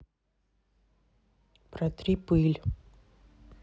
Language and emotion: Russian, neutral